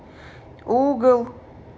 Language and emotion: Russian, neutral